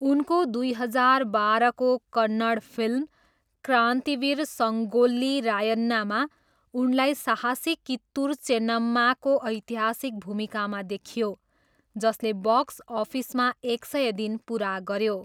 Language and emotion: Nepali, neutral